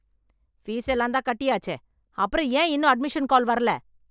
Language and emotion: Tamil, angry